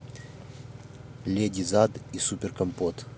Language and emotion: Russian, neutral